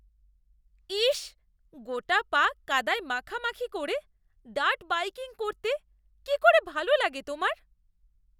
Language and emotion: Bengali, disgusted